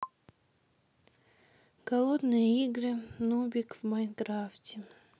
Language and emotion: Russian, sad